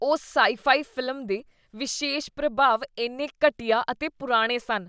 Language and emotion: Punjabi, disgusted